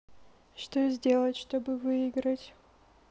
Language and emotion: Russian, sad